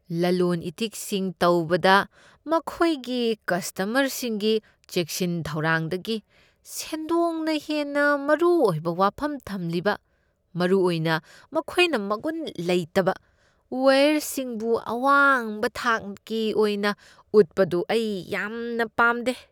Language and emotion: Manipuri, disgusted